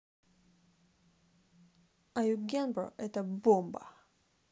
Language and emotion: Russian, neutral